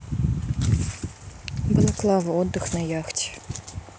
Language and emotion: Russian, neutral